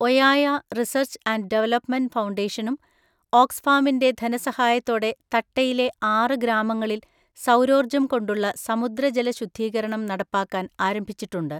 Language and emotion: Malayalam, neutral